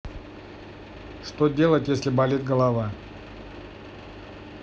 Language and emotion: Russian, neutral